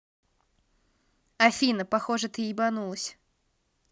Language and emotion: Russian, neutral